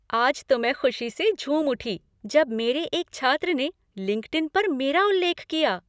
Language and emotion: Hindi, happy